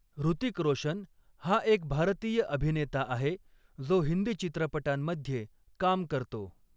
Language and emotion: Marathi, neutral